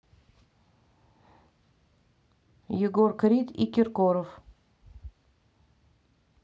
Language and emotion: Russian, neutral